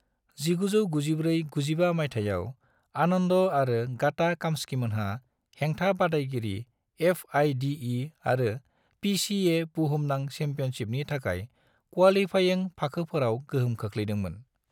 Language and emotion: Bodo, neutral